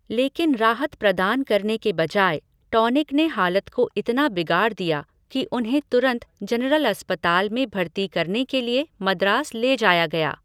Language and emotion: Hindi, neutral